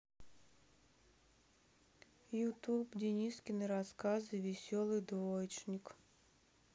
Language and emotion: Russian, sad